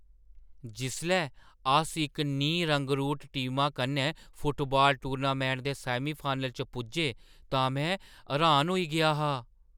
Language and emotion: Dogri, surprised